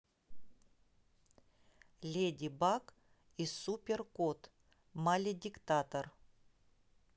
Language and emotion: Russian, neutral